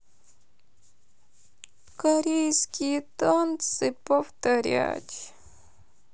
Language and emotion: Russian, sad